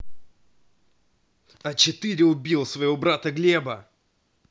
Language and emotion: Russian, angry